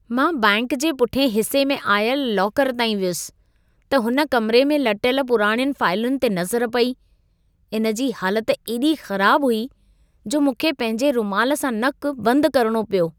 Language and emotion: Sindhi, disgusted